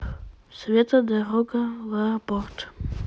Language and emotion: Russian, neutral